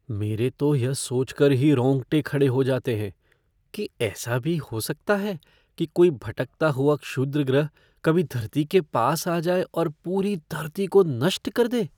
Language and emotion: Hindi, fearful